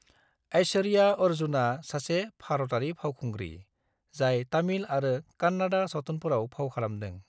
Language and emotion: Bodo, neutral